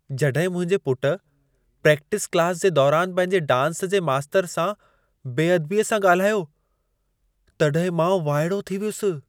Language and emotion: Sindhi, surprised